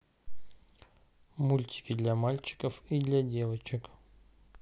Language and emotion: Russian, neutral